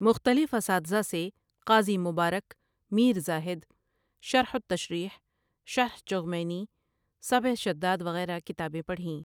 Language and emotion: Urdu, neutral